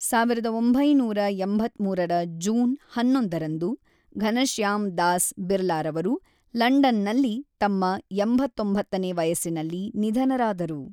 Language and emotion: Kannada, neutral